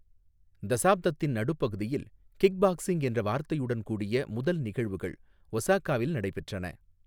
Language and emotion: Tamil, neutral